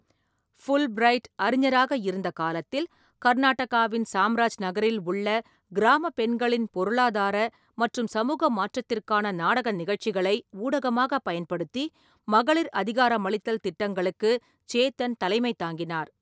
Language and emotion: Tamil, neutral